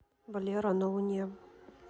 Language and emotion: Russian, neutral